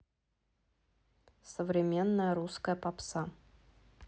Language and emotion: Russian, neutral